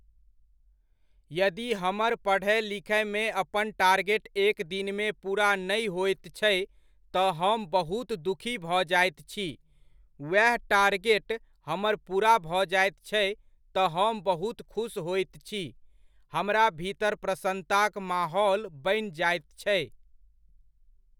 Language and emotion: Maithili, neutral